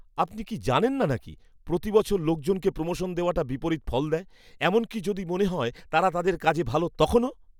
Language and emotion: Bengali, disgusted